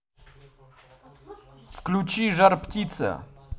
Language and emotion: Russian, angry